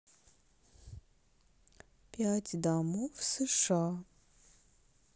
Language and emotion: Russian, neutral